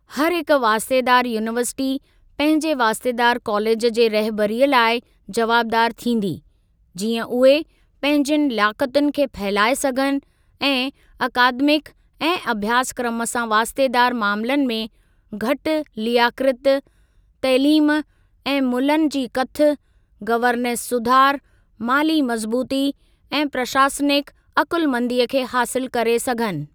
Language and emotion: Sindhi, neutral